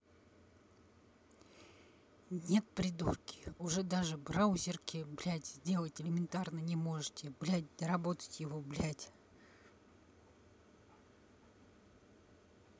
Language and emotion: Russian, angry